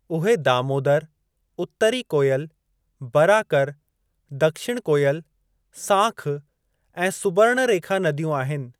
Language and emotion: Sindhi, neutral